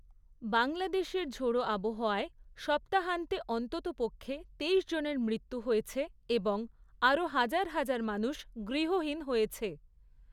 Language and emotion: Bengali, neutral